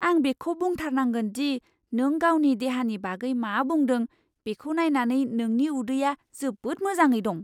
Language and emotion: Bodo, surprised